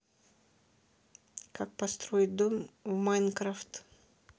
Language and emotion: Russian, neutral